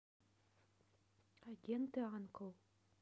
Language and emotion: Russian, neutral